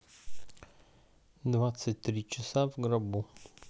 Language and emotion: Russian, neutral